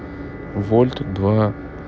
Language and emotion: Russian, neutral